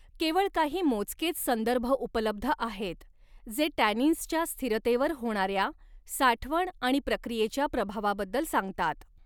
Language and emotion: Marathi, neutral